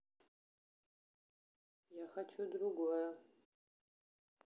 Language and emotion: Russian, neutral